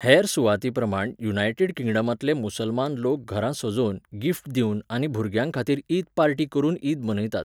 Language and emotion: Goan Konkani, neutral